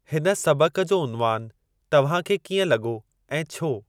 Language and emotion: Sindhi, neutral